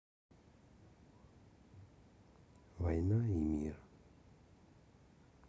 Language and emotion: Russian, sad